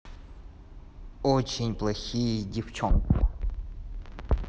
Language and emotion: Russian, neutral